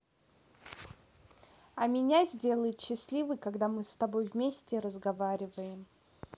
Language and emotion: Russian, positive